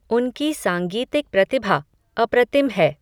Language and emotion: Hindi, neutral